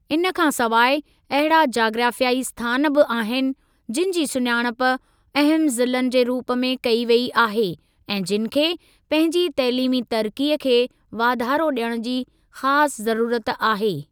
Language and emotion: Sindhi, neutral